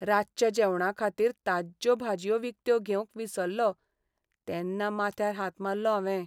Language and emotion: Goan Konkani, sad